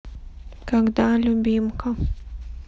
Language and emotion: Russian, sad